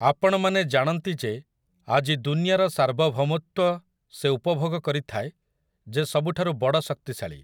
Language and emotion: Odia, neutral